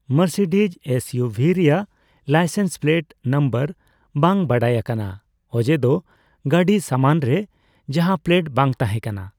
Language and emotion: Santali, neutral